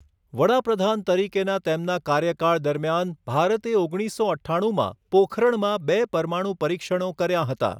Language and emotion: Gujarati, neutral